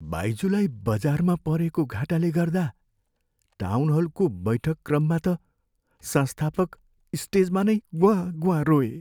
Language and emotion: Nepali, sad